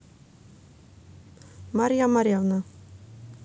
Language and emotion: Russian, neutral